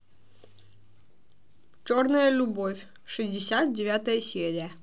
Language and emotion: Russian, neutral